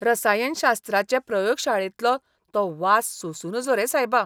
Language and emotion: Goan Konkani, disgusted